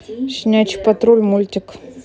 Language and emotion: Russian, neutral